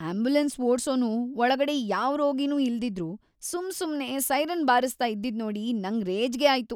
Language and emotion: Kannada, disgusted